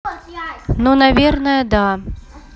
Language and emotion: Russian, neutral